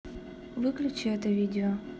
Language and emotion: Russian, neutral